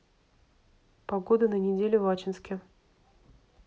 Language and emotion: Russian, neutral